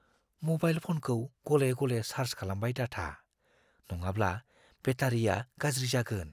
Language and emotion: Bodo, fearful